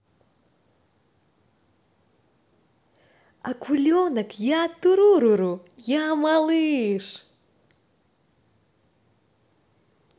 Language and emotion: Russian, positive